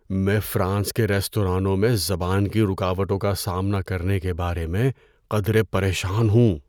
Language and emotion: Urdu, fearful